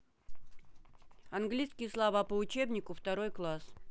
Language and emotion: Russian, neutral